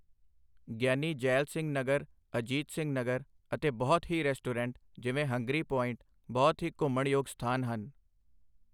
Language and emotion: Punjabi, neutral